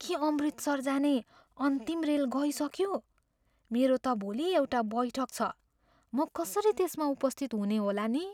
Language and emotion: Nepali, fearful